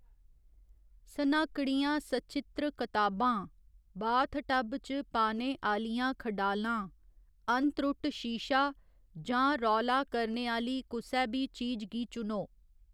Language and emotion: Dogri, neutral